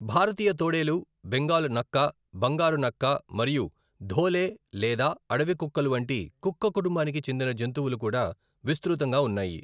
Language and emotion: Telugu, neutral